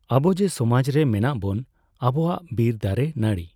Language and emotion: Santali, neutral